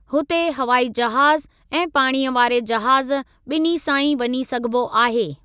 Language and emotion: Sindhi, neutral